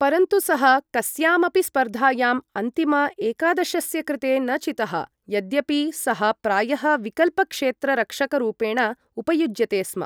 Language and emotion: Sanskrit, neutral